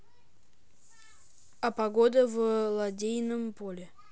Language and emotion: Russian, neutral